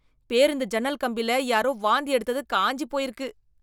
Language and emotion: Tamil, disgusted